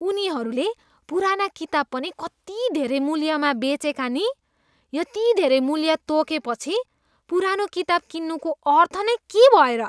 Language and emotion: Nepali, disgusted